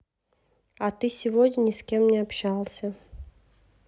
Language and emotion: Russian, neutral